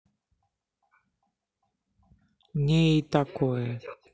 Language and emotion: Russian, neutral